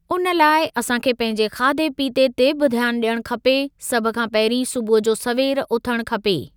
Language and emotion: Sindhi, neutral